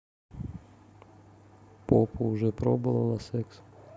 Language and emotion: Russian, neutral